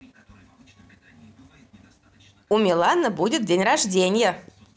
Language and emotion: Russian, positive